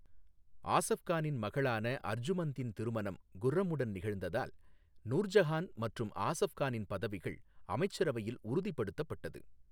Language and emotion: Tamil, neutral